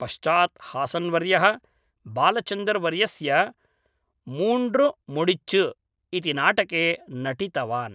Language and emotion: Sanskrit, neutral